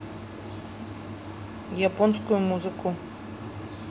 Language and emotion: Russian, neutral